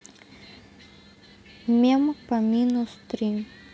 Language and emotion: Russian, neutral